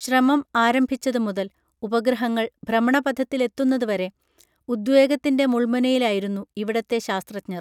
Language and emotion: Malayalam, neutral